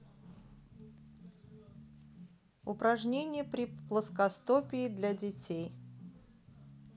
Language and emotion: Russian, neutral